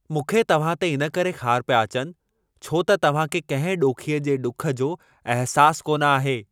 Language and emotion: Sindhi, angry